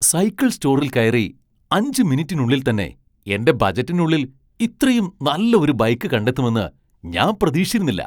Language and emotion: Malayalam, surprised